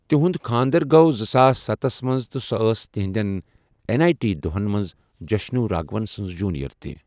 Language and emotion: Kashmiri, neutral